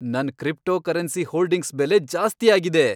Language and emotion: Kannada, happy